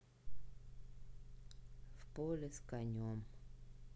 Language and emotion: Russian, sad